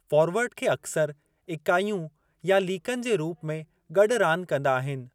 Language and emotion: Sindhi, neutral